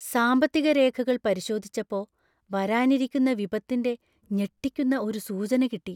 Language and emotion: Malayalam, fearful